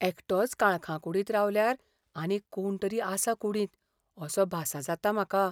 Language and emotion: Goan Konkani, fearful